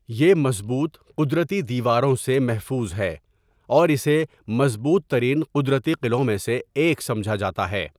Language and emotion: Urdu, neutral